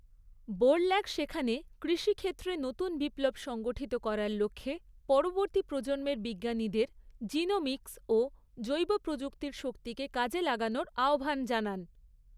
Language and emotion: Bengali, neutral